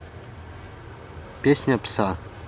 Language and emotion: Russian, neutral